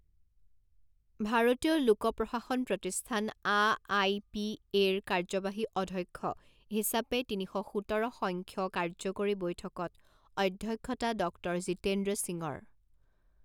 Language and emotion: Assamese, neutral